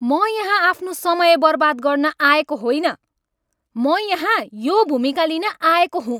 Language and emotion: Nepali, angry